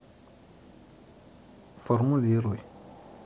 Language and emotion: Russian, neutral